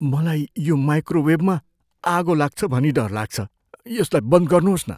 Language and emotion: Nepali, fearful